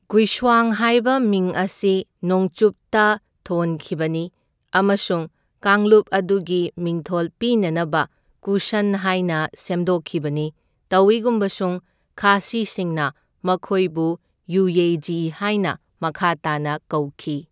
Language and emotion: Manipuri, neutral